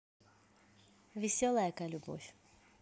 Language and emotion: Russian, positive